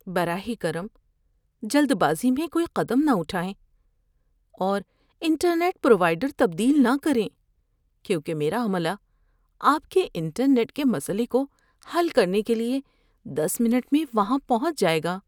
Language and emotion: Urdu, fearful